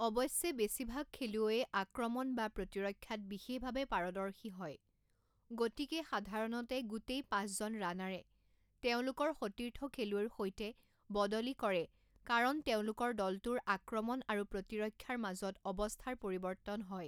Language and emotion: Assamese, neutral